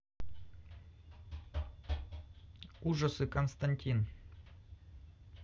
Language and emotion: Russian, neutral